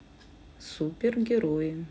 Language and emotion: Russian, neutral